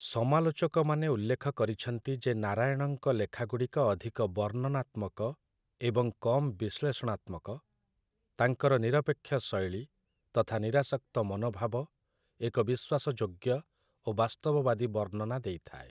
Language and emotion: Odia, neutral